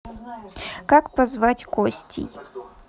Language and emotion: Russian, neutral